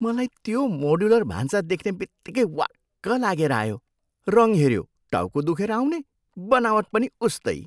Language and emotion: Nepali, disgusted